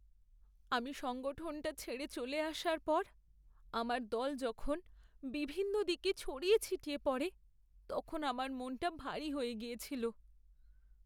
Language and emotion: Bengali, sad